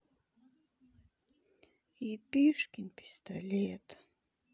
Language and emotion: Russian, sad